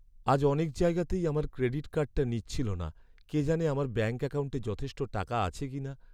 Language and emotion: Bengali, sad